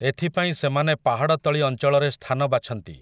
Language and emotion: Odia, neutral